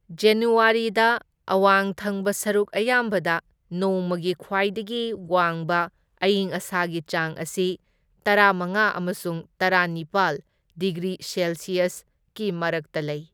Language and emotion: Manipuri, neutral